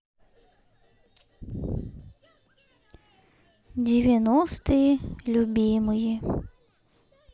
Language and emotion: Russian, sad